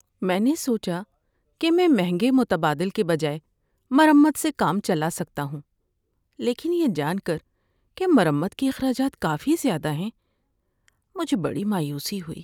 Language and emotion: Urdu, sad